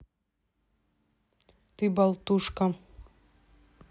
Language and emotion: Russian, neutral